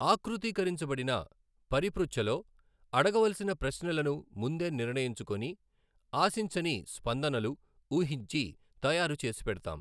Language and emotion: Telugu, neutral